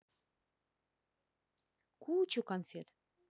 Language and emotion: Russian, positive